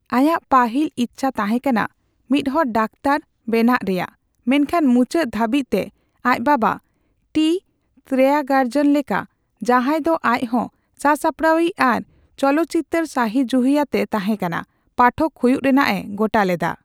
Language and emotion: Santali, neutral